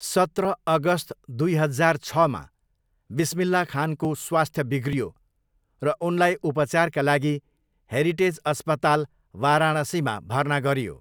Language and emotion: Nepali, neutral